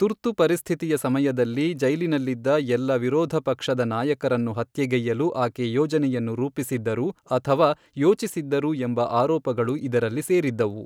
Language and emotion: Kannada, neutral